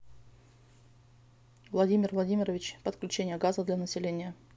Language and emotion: Russian, neutral